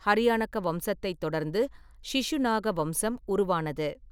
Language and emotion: Tamil, neutral